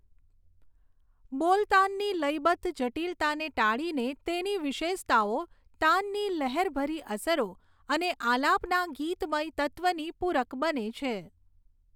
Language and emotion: Gujarati, neutral